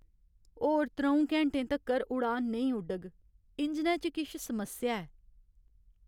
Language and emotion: Dogri, sad